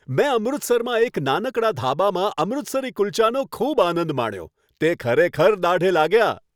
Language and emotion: Gujarati, happy